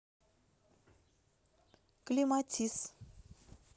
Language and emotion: Russian, neutral